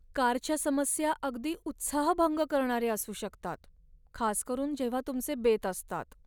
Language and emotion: Marathi, sad